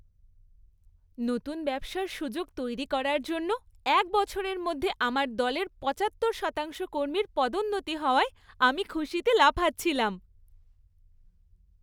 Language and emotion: Bengali, happy